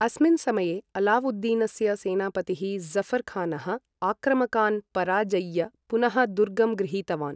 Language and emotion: Sanskrit, neutral